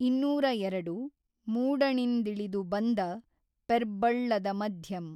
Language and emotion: Kannada, neutral